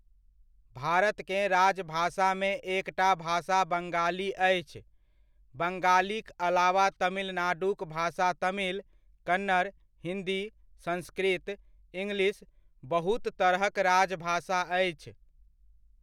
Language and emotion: Maithili, neutral